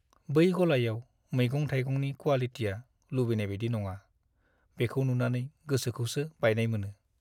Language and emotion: Bodo, sad